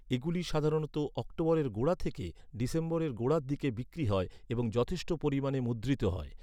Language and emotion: Bengali, neutral